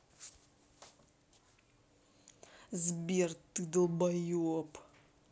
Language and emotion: Russian, angry